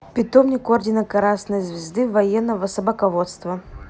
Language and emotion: Russian, neutral